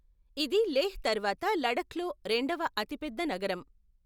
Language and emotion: Telugu, neutral